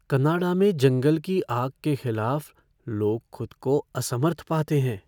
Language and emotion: Hindi, fearful